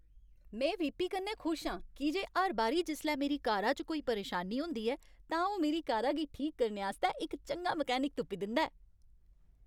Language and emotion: Dogri, happy